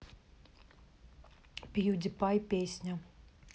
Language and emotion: Russian, neutral